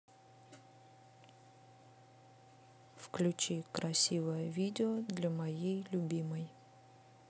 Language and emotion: Russian, neutral